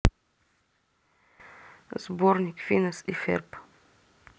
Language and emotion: Russian, neutral